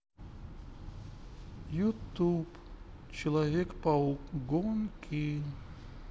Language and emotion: Russian, sad